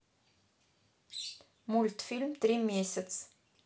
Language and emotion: Russian, neutral